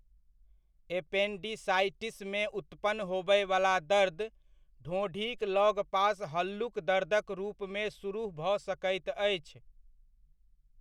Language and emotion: Maithili, neutral